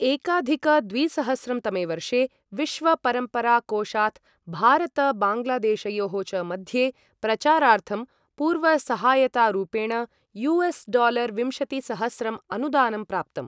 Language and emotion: Sanskrit, neutral